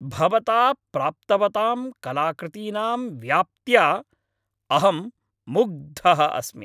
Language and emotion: Sanskrit, happy